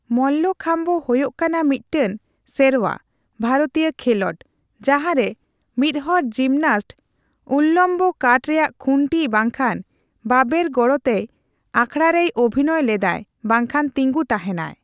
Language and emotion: Santali, neutral